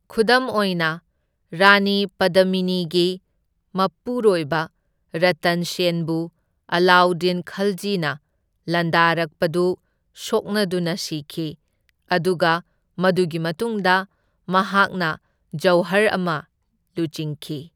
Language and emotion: Manipuri, neutral